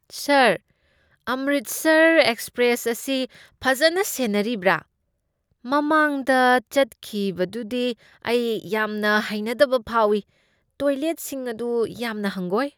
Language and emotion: Manipuri, disgusted